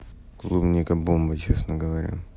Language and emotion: Russian, neutral